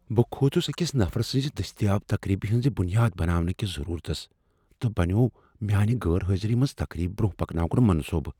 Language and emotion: Kashmiri, fearful